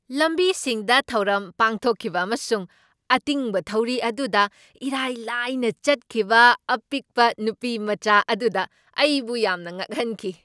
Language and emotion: Manipuri, surprised